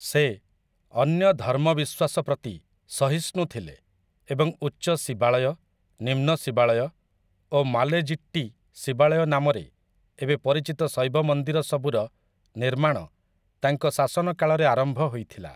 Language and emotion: Odia, neutral